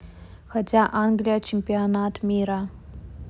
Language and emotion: Russian, neutral